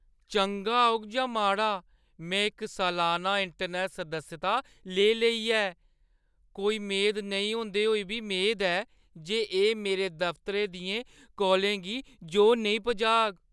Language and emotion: Dogri, fearful